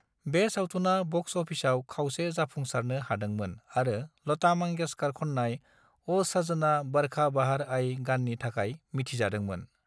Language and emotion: Bodo, neutral